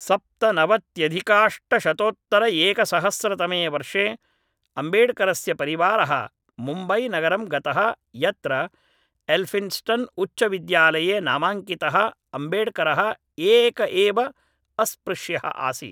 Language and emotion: Sanskrit, neutral